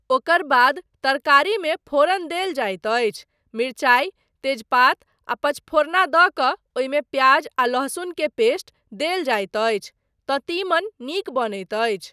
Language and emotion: Maithili, neutral